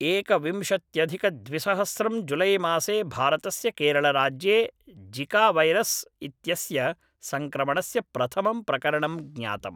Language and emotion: Sanskrit, neutral